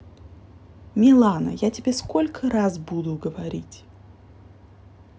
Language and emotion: Russian, angry